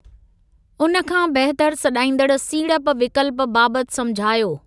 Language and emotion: Sindhi, neutral